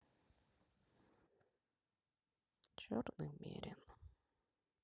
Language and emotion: Russian, sad